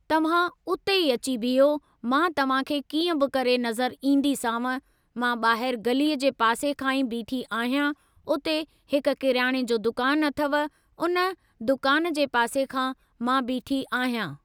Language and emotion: Sindhi, neutral